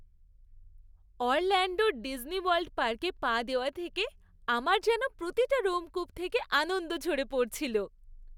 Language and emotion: Bengali, happy